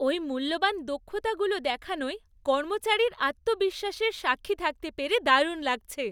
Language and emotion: Bengali, happy